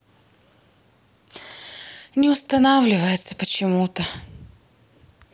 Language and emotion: Russian, sad